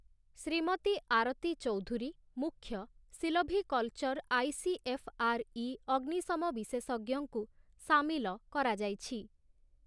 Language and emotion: Odia, neutral